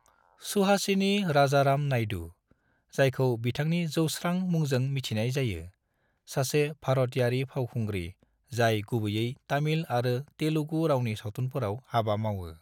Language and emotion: Bodo, neutral